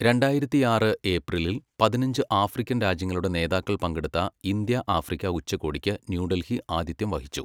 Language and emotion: Malayalam, neutral